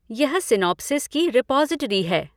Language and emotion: Hindi, neutral